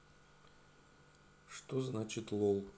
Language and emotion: Russian, neutral